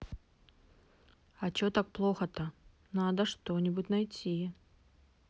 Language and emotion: Russian, neutral